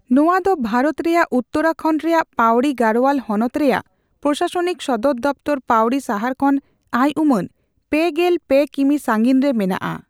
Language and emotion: Santali, neutral